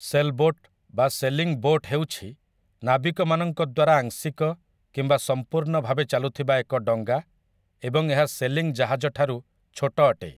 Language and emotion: Odia, neutral